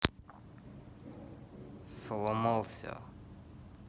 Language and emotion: Russian, neutral